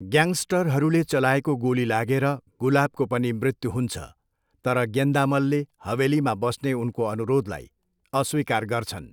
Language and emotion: Nepali, neutral